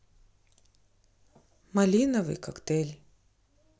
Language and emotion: Russian, neutral